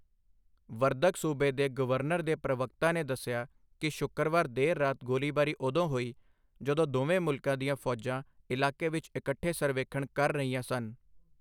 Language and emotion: Punjabi, neutral